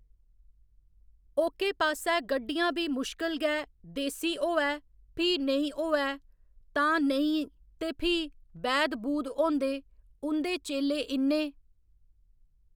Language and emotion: Dogri, neutral